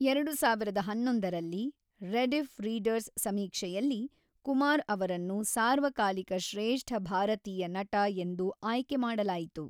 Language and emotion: Kannada, neutral